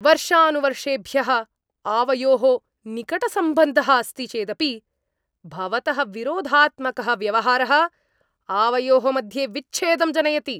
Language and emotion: Sanskrit, angry